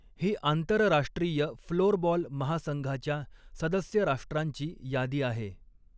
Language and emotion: Marathi, neutral